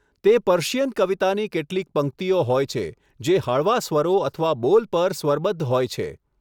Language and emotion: Gujarati, neutral